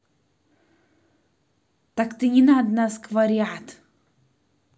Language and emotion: Russian, angry